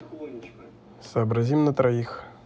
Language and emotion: Russian, neutral